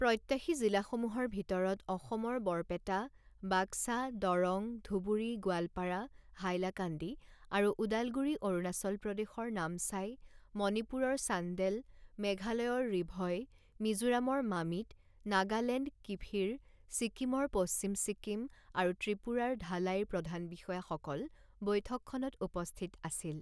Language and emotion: Assamese, neutral